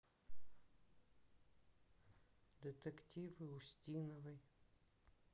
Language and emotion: Russian, sad